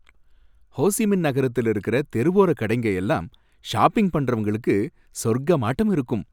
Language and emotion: Tamil, happy